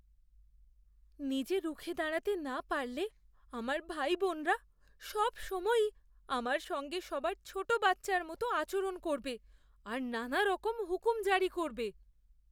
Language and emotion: Bengali, fearful